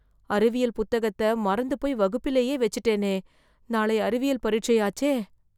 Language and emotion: Tamil, fearful